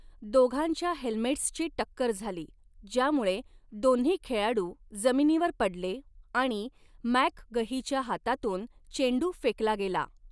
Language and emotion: Marathi, neutral